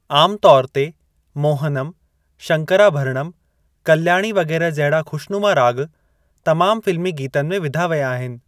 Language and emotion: Sindhi, neutral